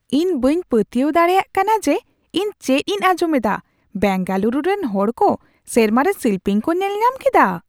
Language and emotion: Santali, surprised